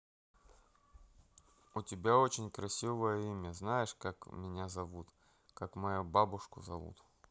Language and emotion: Russian, neutral